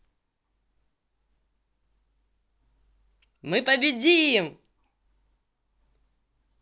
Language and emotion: Russian, positive